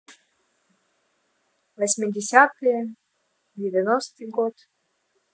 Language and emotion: Russian, neutral